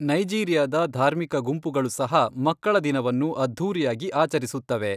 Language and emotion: Kannada, neutral